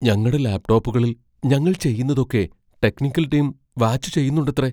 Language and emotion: Malayalam, fearful